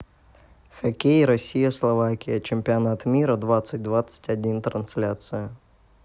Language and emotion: Russian, neutral